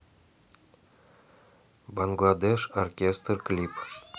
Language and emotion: Russian, neutral